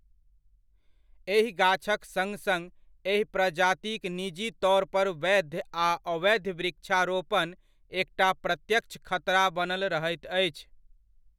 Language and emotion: Maithili, neutral